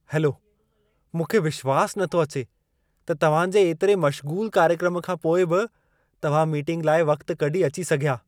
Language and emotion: Sindhi, surprised